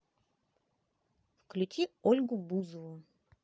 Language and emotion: Russian, positive